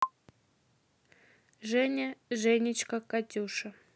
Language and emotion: Russian, neutral